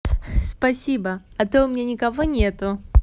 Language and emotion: Russian, positive